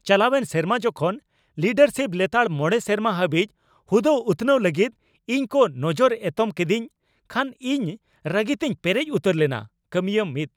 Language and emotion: Santali, angry